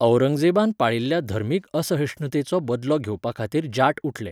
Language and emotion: Goan Konkani, neutral